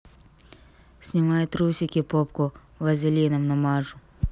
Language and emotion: Russian, neutral